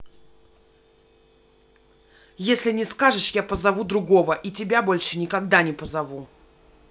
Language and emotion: Russian, angry